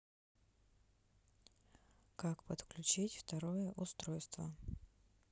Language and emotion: Russian, neutral